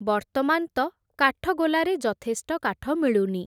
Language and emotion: Odia, neutral